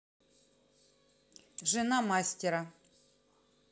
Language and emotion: Russian, neutral